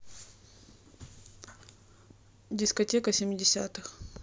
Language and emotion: Russian, neutral